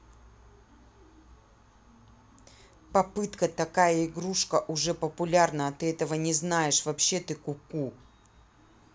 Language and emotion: Russian, angry